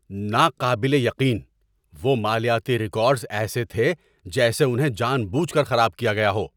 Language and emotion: Urdu, angry